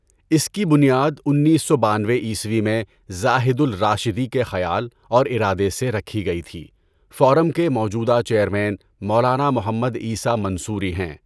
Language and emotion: Urdu, neutral